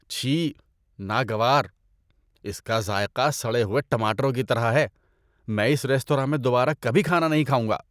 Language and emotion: Urdu, disgusted